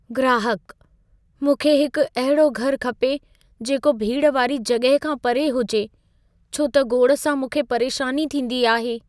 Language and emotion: Sindhi, fearful